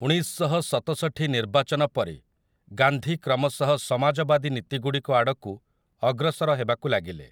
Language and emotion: Odia, neutral